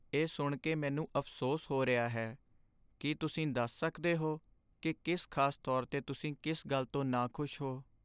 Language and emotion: Punjabi, sad